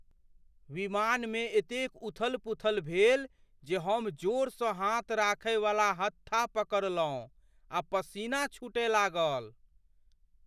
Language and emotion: Maithili, fearful